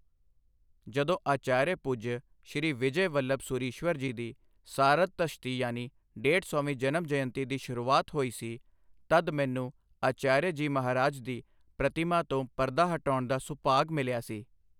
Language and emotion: Punjabi, neutral